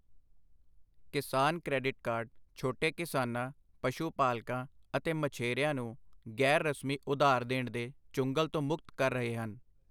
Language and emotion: Punjabi, neutral